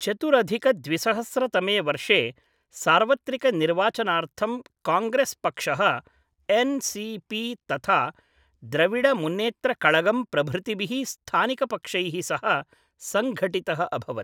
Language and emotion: Sanskrit, neutral